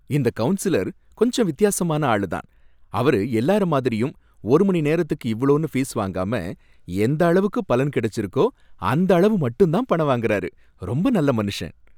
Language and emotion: Tamil, happy